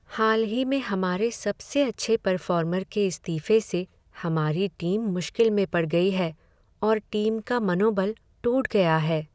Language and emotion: Hindi, sad